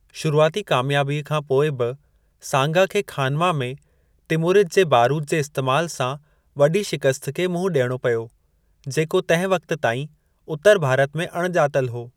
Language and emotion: Sindhi, neutral